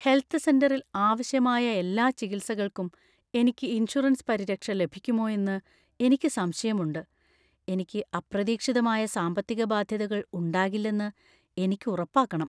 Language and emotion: Malayalam, fearful